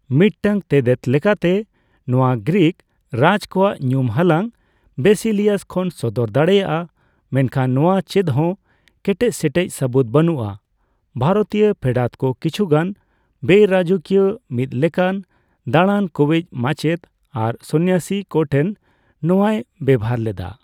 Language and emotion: Santali, neutral